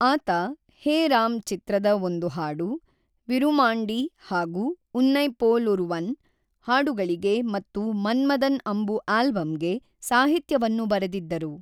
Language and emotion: Kannada, neutral